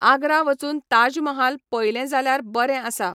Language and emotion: Goan Konkani, neutral